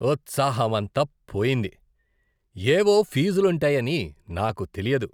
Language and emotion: Telugu, disgusted